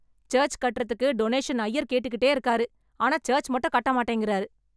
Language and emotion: Tamil, angry